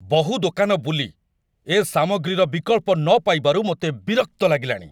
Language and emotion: Odia, angry